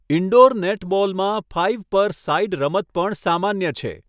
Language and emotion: Gujarati, neutral